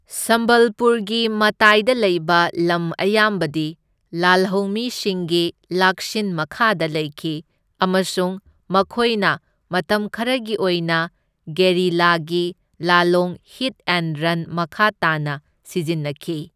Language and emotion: Manipuri, neutral